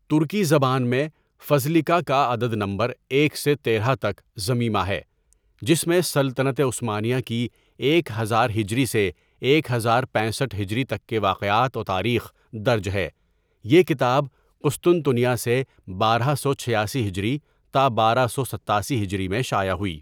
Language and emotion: Urdu, neutral